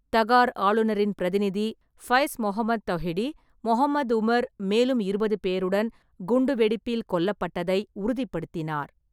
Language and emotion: Tamil, neutral